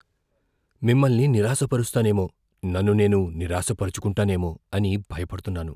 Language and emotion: Telugu, fearful